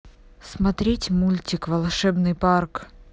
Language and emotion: Russian, neutral